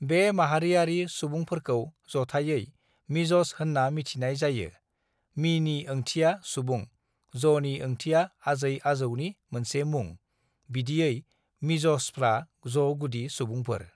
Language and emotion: Bodo, neutral